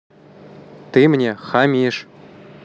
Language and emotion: Russian, neutral